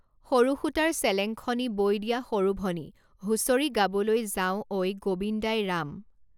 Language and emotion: Assamese, neutral